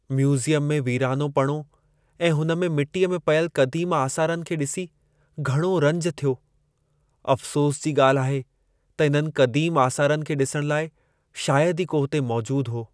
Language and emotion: Sindhi, sad